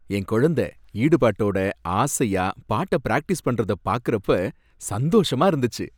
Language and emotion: Tamil, happy